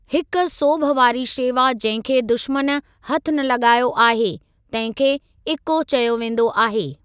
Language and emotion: Sindhi, neutral